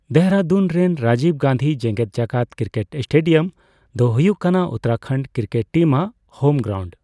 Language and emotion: Santali, neutral